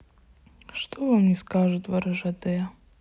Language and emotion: Russian, sad